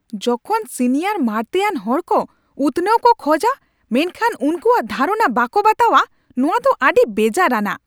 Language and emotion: Santali, angry